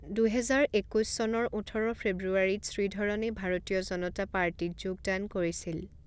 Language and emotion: Assamese, neutral